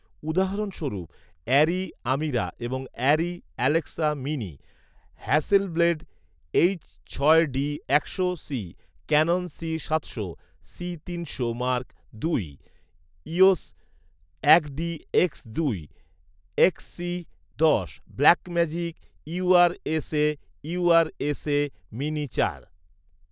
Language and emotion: Bengali, neutral